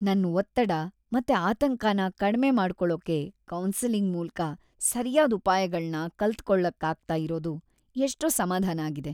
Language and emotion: Kannada, happy